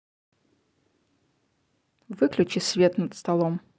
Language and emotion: Russian, neutral